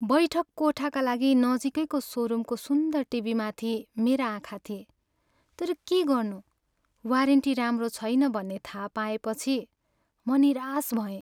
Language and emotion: Nepali, sad